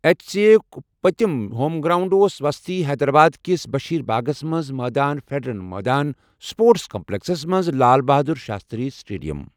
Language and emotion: Kashmiri, neutral